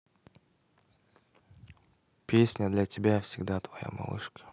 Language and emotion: Russian, neutral